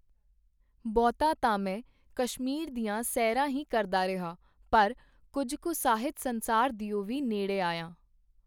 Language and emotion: Punjabi, neutral